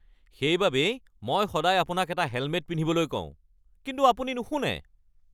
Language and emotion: Assamese, angry